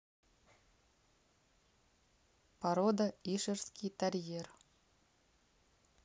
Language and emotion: Russian, neutral